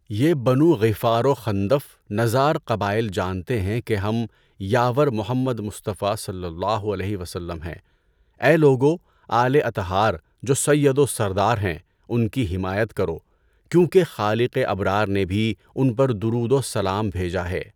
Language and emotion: Urdu, neutral